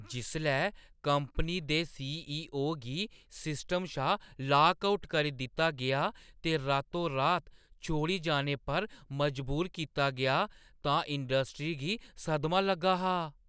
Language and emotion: Dogri, surprised